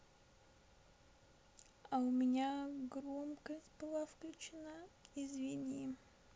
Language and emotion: Russian, sad